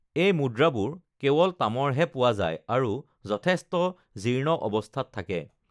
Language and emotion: Assamese, neutral